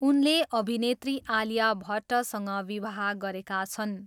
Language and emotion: Nepali, neutral